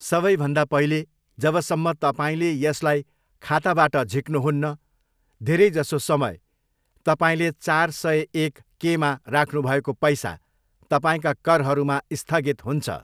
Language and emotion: Nepali, neutral